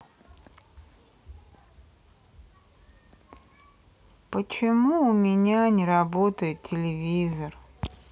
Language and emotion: Russian, sad